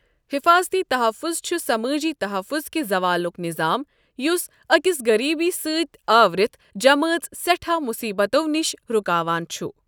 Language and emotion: Kashmiri, neutral